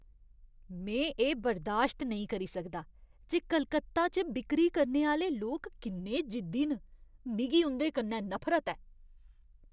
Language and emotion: Dogri, disgusted